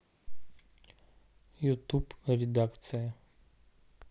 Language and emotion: Russian, neutral